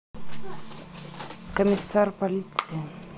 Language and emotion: Russian, neutral